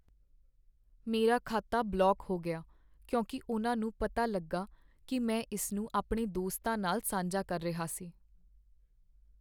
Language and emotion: Punjabi, sad